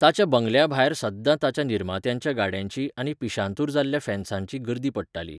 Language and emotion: Goan Konkani, neutral